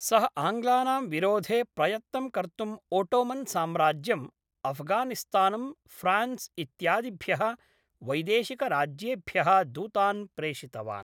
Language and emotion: Sanskrit, neutral